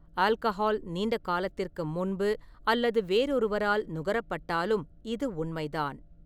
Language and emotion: Tamil, neutral